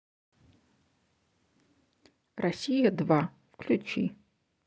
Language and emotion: Russian, neutral